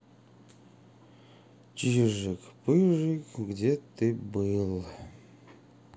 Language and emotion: Russian, sad